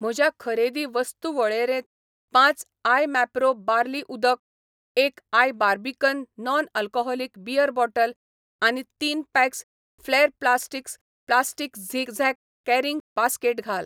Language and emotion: Goan Konkani, neutral